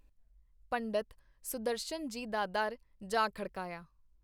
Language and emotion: Punjabi, neutral